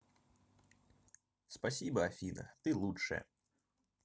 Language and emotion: Russian, neutral